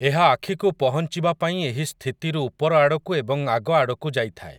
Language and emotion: Odia, neutral